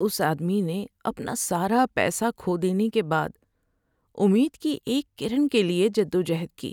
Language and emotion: Urdu, sad